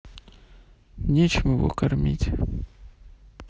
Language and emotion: Russian, sad